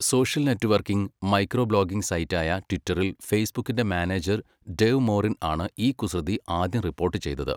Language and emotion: Malayalam, neutral